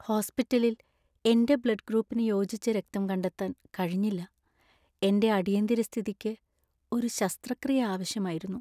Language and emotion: Malayalam, sad